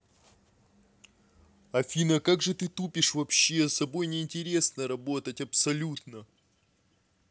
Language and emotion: Russian, angry